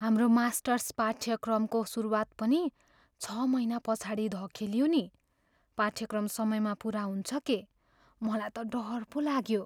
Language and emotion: Nepali, fearful